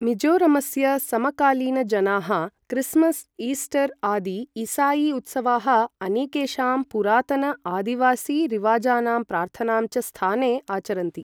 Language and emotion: Sanskrit, neutral